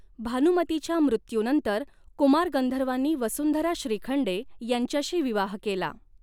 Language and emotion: Marathi, neutral